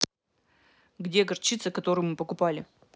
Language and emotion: Russian, angry